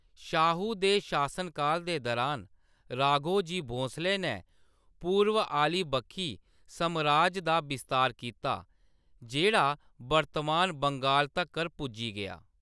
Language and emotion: Dogri, neutral